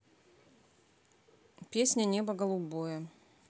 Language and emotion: Russian, neutral